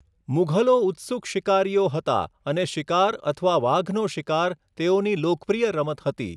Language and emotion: Gujarati, neutral